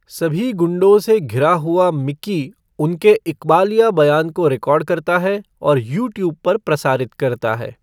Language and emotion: Hindi, neutral